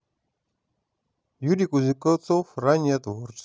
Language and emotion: Russian, neutral